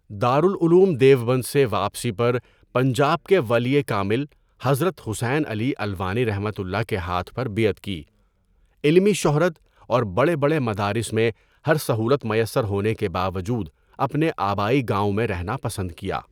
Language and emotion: Urdu, neutral